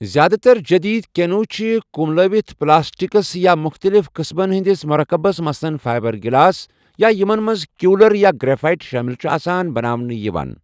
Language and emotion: Kashmiri, neutral